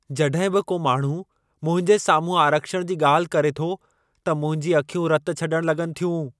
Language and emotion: Sindhi, angry